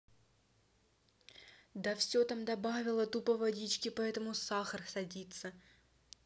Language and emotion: Russian, angry